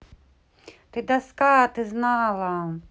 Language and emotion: Russian, neutral